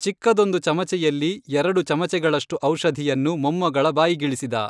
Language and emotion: Kannada, neutral